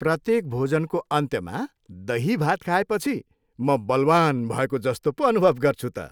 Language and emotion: Nepali, happy